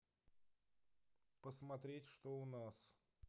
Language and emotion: Russian, neutral